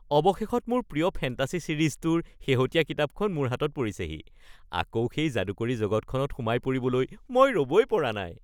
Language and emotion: Assamese, happy